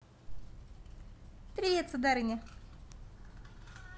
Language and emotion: Russian, positive